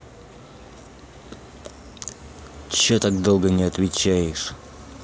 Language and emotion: Russian, angry